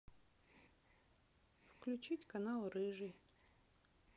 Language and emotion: Russian, neutral